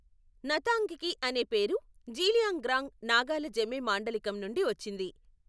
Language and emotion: Telugu, neutral